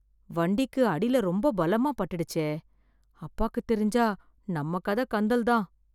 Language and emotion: Tamil, fearful